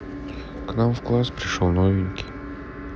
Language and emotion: Russian, sad